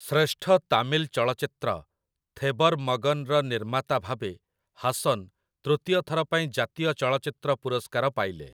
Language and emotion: Odia, neutral